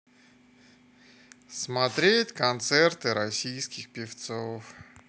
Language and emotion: Russian, sad